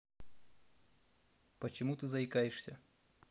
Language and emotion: Russian, neutral